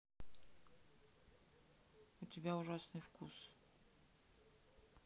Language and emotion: Russian, sad